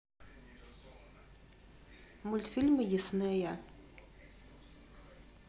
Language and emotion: Russian, neutral